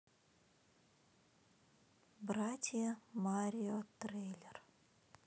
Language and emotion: Russian, neutral